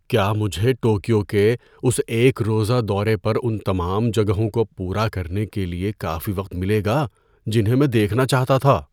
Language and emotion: Urdu, fearful